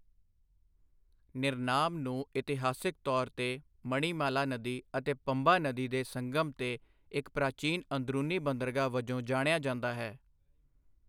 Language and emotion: Punjabi, neutral